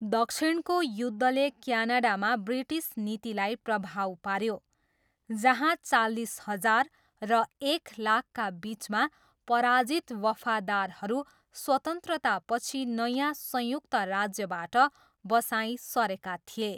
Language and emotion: Nepali, neutral